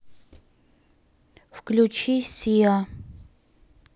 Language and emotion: Russian, neutral